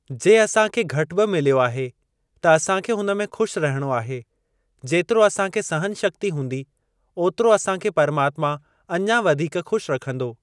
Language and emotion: Sindhi, neutral